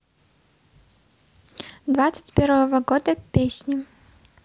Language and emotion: Russian, neutral